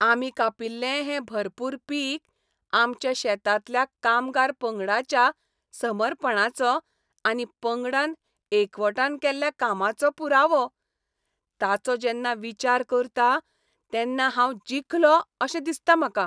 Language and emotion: Goan Konkani, happy